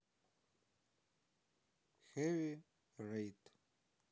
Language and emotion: Russian, sad